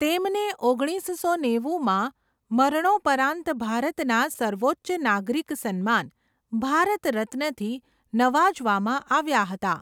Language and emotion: Gujarati, neutral